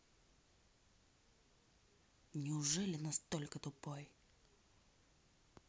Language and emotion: Russian, angry